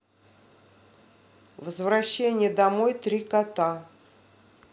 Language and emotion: Russian, neutral